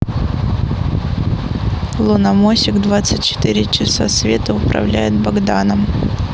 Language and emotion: Russian, neutral